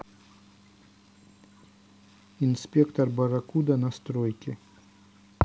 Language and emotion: Russian, neutral